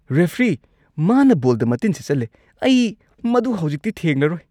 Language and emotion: Manipuri, disgusted